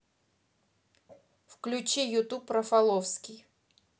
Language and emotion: Russian, neutral